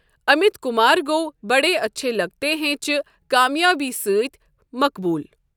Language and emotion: Kashmiri, neutral